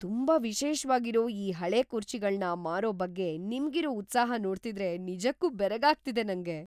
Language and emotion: Kannada, surprised